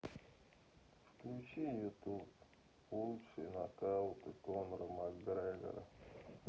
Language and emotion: Russian, sad